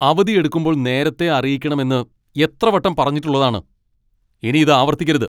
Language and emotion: Malayalam, angry